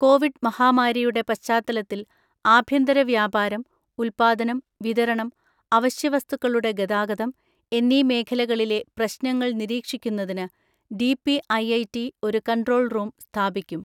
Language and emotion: Malayalam, neutral